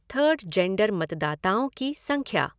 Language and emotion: Hindi, neutral